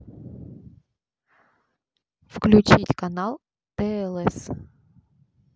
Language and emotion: Russian, neutral